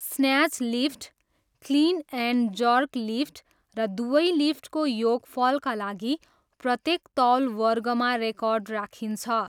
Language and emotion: Nepali, neutral